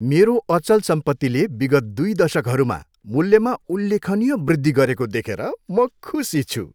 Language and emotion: Nepali, happy